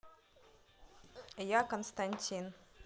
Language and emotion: Russian, neutral